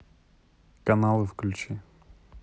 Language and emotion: Russian, neutral